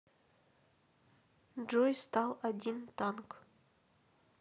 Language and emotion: Russian, neutral